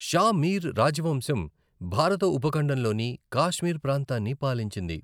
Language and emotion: Telugu, neutral